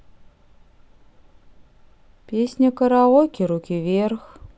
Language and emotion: Russian, neutral